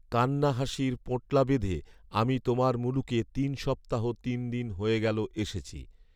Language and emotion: Bengali, neutral